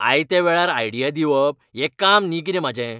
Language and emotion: Goan Konkani, angry